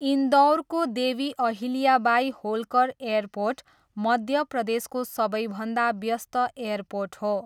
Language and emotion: Nepali, neutral